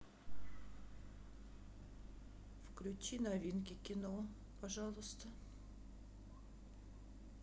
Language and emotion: Russian, sad